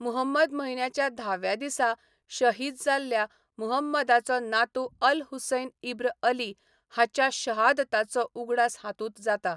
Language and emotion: Goan Konkani, neutral